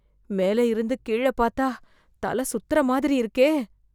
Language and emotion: Tamil, fearful